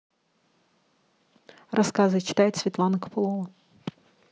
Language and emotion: Russian, neutral